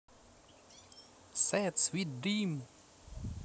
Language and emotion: Russian, neutral